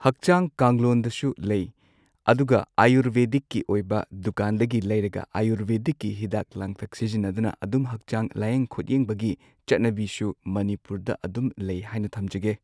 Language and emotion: Manipuri, neutral